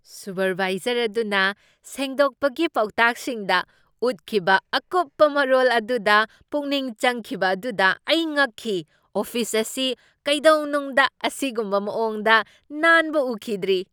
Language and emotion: Manipuri, surprised